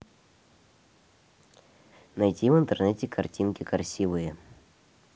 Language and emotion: Russian, neutral